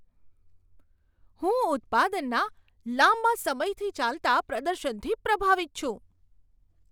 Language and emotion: Gujarati, surprised